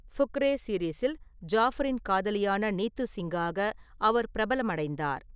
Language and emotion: Tamil, neutral